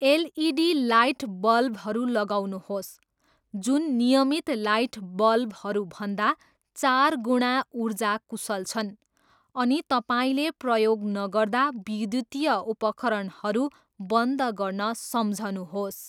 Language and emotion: Nepali, neutral